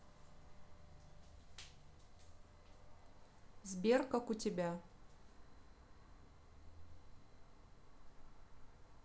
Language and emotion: Russian, neutral